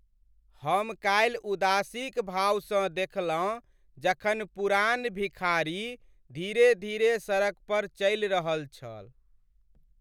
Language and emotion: Maithili, sad